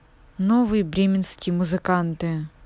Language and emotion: Russian, neutral